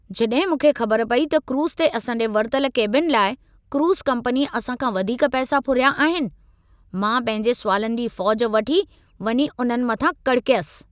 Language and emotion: Sindhi, angry